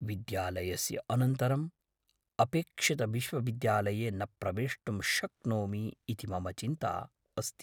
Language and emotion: Sanskrit, fearful